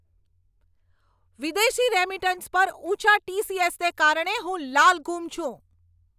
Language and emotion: Gujarati, angry